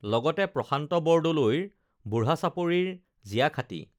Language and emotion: Assamese, neutral